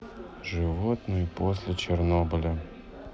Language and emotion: Russian, neutral